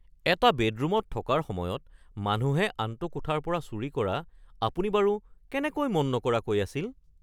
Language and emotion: Assamese, surprised